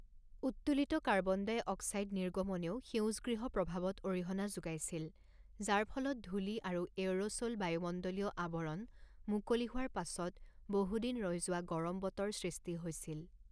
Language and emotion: Assamese, neutral